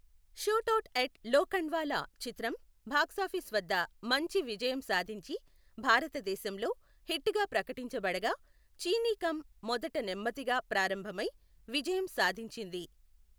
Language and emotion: Telugu, neutral